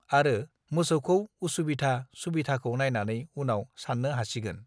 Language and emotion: Bodo, neutral